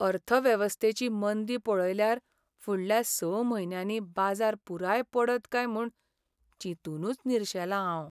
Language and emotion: Goan Konkani, sad